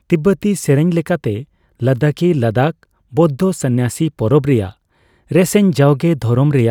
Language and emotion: Santali, neutral